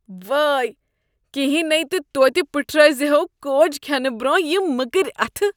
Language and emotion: Kashmiri, disgusted